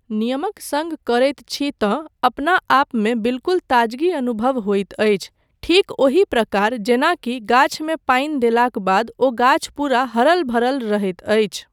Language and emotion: Maithili, neutral